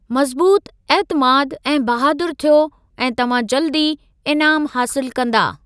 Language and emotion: Sindhi, neutral